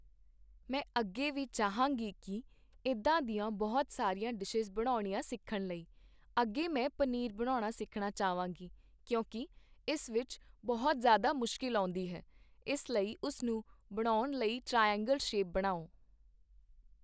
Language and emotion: Punjabi, neutral